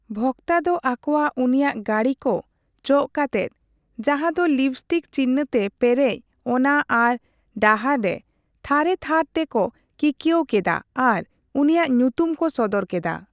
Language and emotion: Santali, neutral